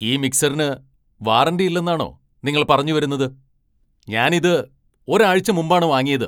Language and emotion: Malayalam, angry